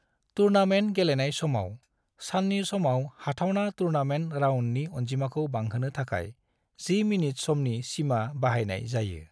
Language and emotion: Bodo, neutral